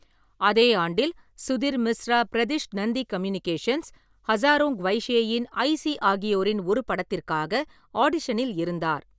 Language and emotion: Tamil, neutral